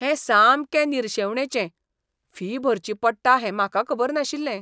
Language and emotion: Goan Konkani, disgusted